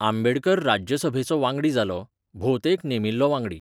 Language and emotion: Goan Konkani, neutral